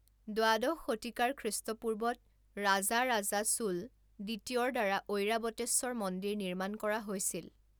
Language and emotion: Assamese, neutral